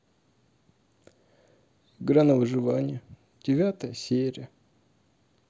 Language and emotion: Russian, sad